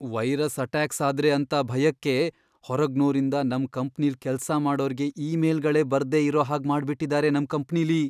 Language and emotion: Kannada, fearful